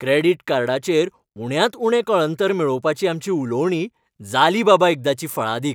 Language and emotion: Goan Konkani, happy